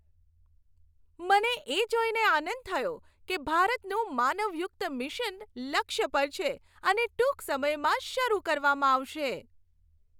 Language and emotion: Gujarati, happy